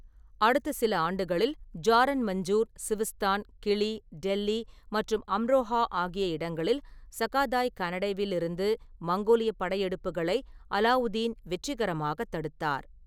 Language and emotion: Tamil, neutral